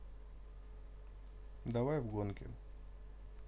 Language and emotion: Russian, neutral